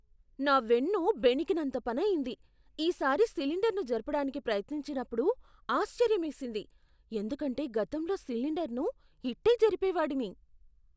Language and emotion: Telugu, surprised